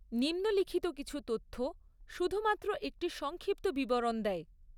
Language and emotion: Bengali, neutral